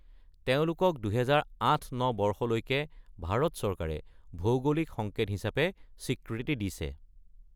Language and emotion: Assamese, neutral